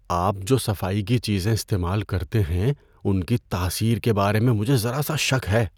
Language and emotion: Urdu, fearful